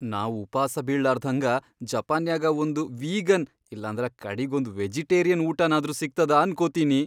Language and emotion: Kannada, fearful